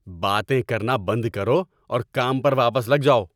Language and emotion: Urdu, angry